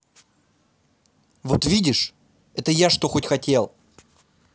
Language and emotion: Russian, angry